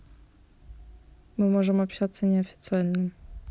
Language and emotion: Russian, neutral